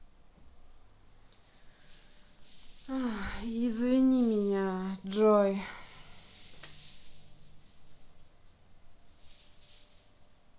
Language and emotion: Russian, sad